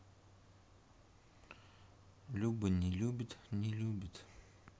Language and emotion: Russian, sad